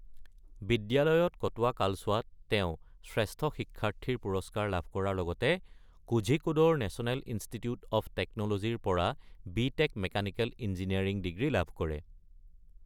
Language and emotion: Assamese, neutral